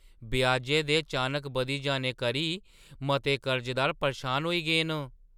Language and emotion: Dogri, surprised